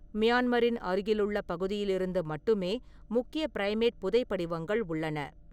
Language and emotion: Tamil, neutral